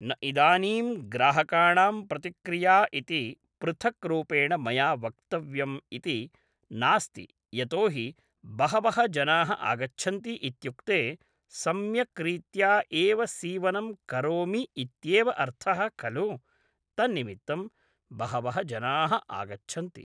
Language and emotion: Sanskrit, neutral